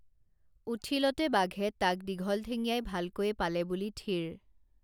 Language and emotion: Assamese, neutral